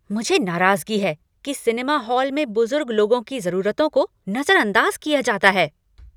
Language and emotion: Hindi, angry